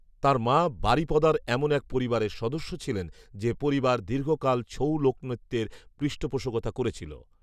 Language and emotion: Bengali, neutral